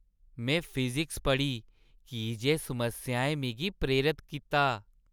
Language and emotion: Dogri, happy